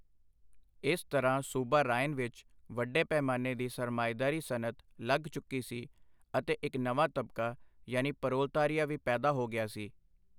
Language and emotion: Punjabi, neutral